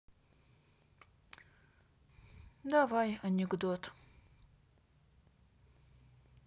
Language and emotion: Russian, sad